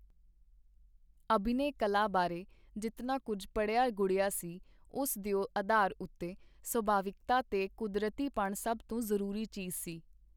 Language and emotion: Punjabi, neutral